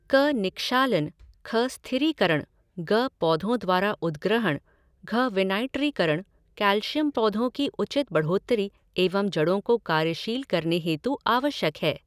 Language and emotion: Hindi, neutral